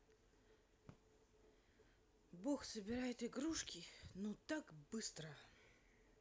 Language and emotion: Russian, sad